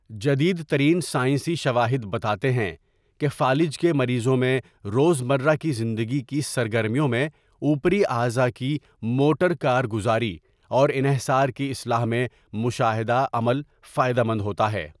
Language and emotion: Urdu, neutral